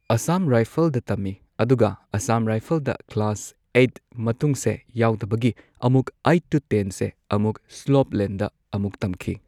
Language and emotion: Manipuri, neutral